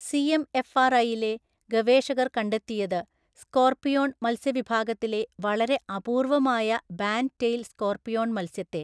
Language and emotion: Malayalam, neutral